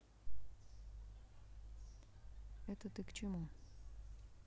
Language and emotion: Russian, neutral